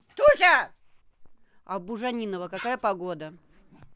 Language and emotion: Russian, angry